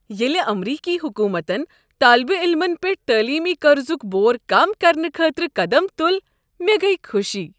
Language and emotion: Kashmiri, happy